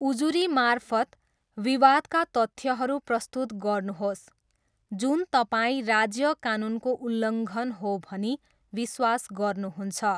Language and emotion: Nepali, neutral